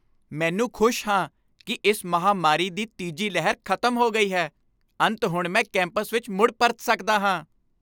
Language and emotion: Punjabi, happy